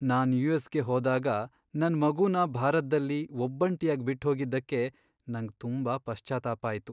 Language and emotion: Kannada, sad